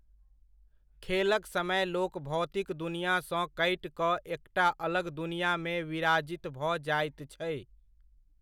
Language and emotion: Maithili, neutral